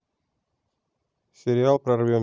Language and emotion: Russian, neutral